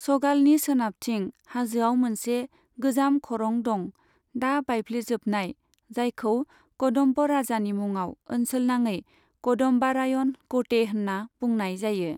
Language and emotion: Bodo, neutral